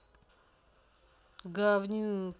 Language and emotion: Russian, angry